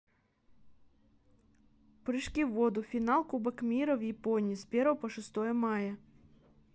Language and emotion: Russian, neutral